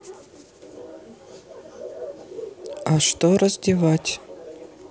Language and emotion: Russian, neutral